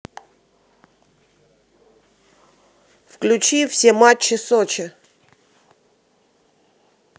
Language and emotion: Russian, neutral